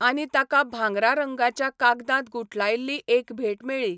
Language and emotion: Goan Konkani, neutral